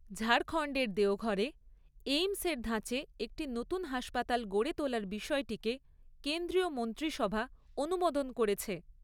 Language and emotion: Bengali, neutral